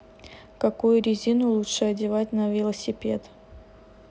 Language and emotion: Russian, neutral